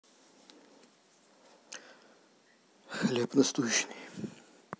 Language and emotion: Russian, neutral